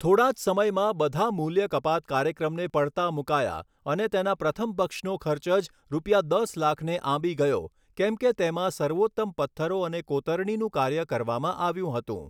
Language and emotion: Gujarati, neutral